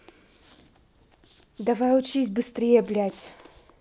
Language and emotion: Russian, angry